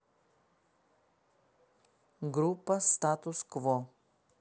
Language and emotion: Russian, neutral